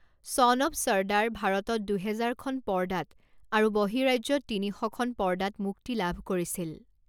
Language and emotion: Assamese, neutral